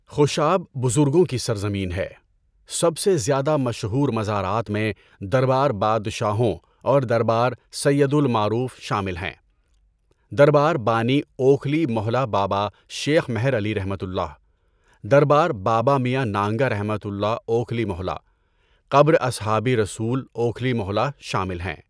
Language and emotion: Urdu, neutral